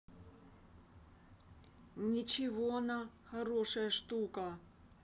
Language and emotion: Russian, neutral